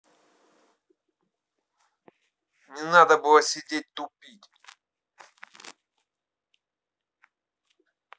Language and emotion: Russian, angry